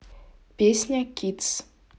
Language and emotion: Russian, neutral